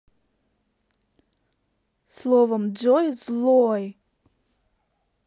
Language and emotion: Russian, neutral